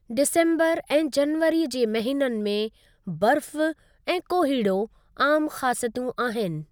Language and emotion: Sindhi, neutral